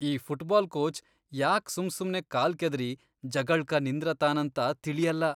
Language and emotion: Kannada, disgusted